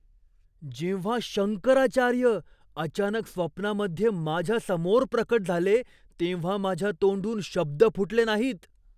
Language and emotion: Marathi, surprised